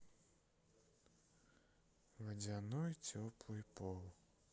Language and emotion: Russian, sad